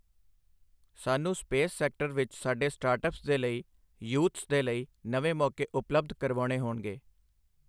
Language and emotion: Punjabi, neutral